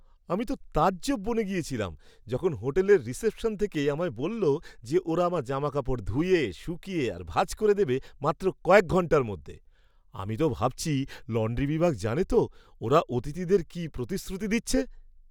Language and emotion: Bengali, surprised